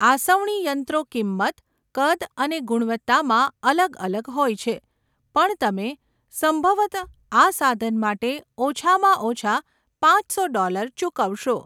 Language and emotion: Gujarati, neutral